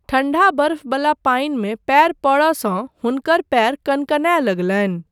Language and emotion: Maithili, neutral